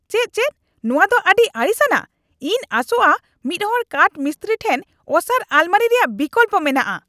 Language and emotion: Santali, angry